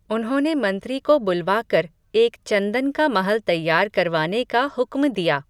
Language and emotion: Hindi, neutral